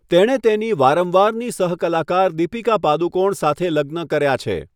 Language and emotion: Gujarati, neutral